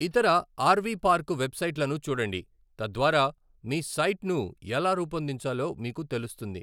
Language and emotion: Telugu, neutral